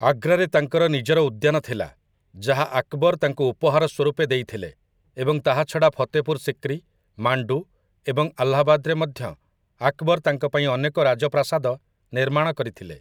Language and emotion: Odia, neutral